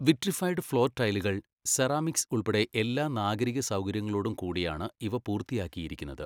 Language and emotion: Malayalam, neutral